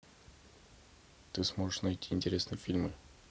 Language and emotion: Russian, neutral